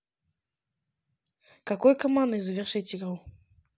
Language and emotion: Russian, neutral